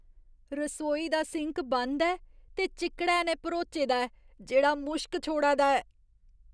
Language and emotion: Dogri, disgusted